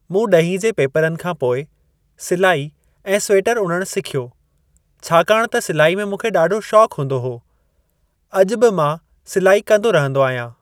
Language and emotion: Sindhi, neutral